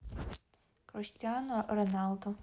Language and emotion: Russian, neutral